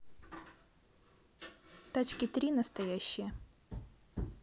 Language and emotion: Russian, neutral